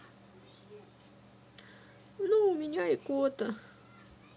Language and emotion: Russian, sad